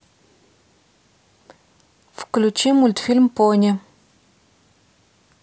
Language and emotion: Russian, neutral